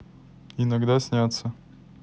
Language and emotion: Russian, neutral